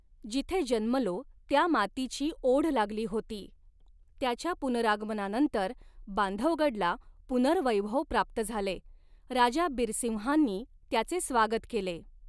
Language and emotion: Marathi, neutral